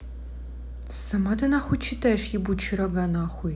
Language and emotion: Russian, angry